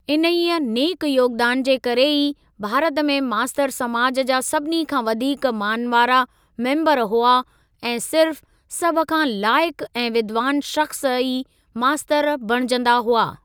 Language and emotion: Sindhi, neutral